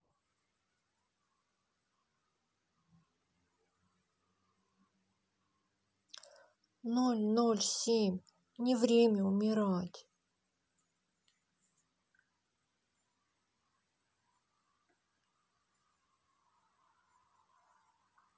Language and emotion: Russian, sad